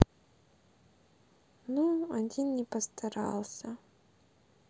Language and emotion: Russian, sad